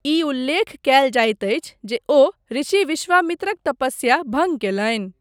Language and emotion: Maithili, neutral